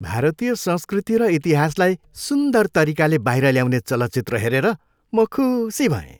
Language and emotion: Nepali, happy